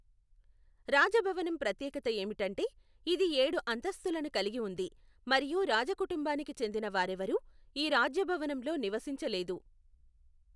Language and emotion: Telugu, neutral